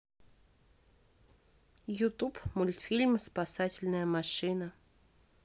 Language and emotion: Russian, neutral